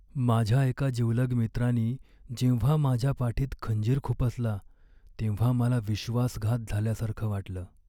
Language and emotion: Marathi, sad